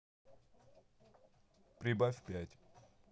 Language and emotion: Russian, neutral